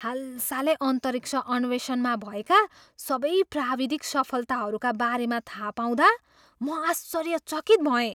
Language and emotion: Nepali, surprised